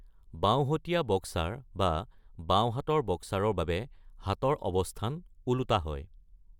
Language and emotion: Assamese, neutral